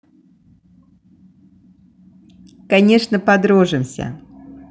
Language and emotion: Russian, positive